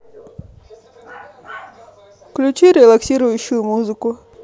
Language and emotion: Russian, neutral